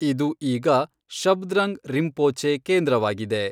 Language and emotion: Kannada, neutral